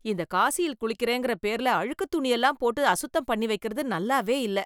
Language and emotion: Tamil, disgusted